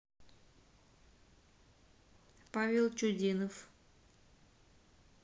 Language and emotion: Russian, neutral